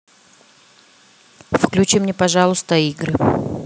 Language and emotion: Russian, neutral